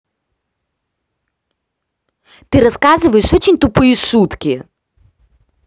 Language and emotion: Russian, angry